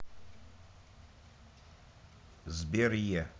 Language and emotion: Russian, neutral